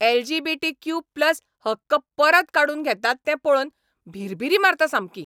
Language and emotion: Goan Konkani, angry